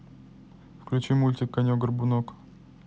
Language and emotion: Russian, neutral